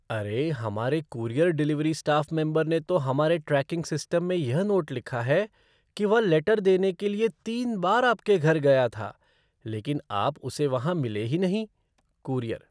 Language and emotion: Hindi, surprised